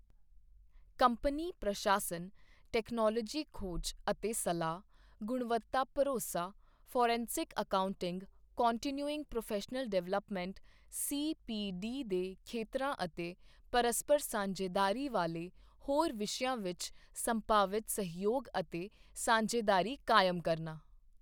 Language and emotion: Punjabi, neutral